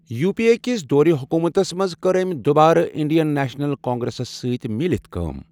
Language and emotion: Kashmiri, neutral